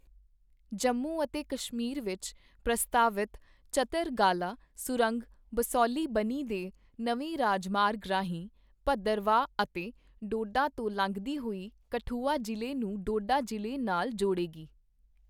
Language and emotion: Punjabi, neutral